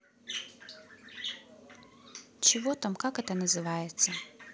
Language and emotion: Russian, neutral